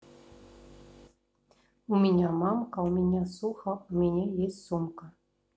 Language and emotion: Russian, neutral